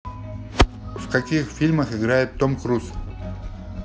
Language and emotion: Russian, neutral